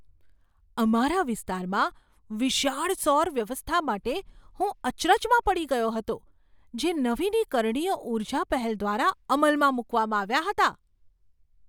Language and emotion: Gujarati, surprised